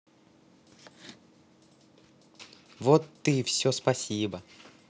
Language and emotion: Russian, positive